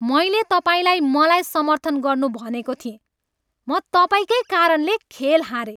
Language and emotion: Nepali, angry